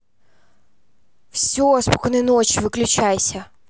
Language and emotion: Russian, angry